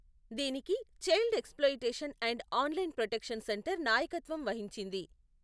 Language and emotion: Telugu, neutral